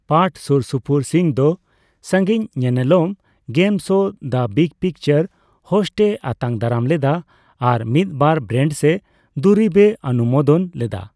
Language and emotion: Santali, neutral